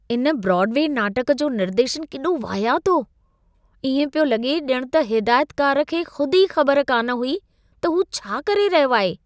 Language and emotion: Sindhi, disgusted